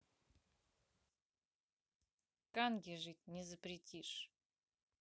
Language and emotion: Russian, neutral